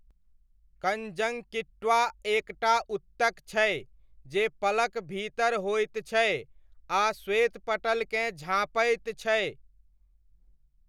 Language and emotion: Maithili, neutral